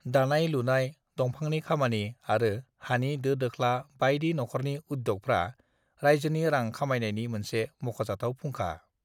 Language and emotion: Bodo, neutral